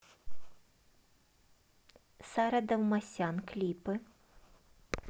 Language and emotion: Russian, neutral